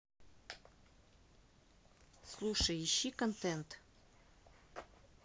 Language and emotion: Russian, neutral